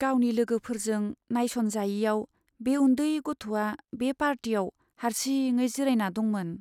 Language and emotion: Bodo, sad